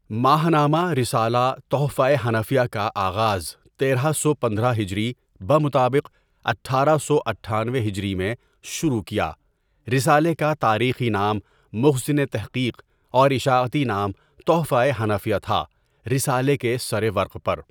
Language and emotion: Urdu, neutral